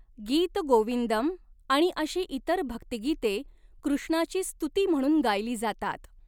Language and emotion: Marathi, neutral